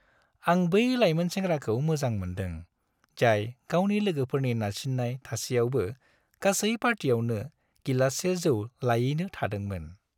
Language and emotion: Bodo, happy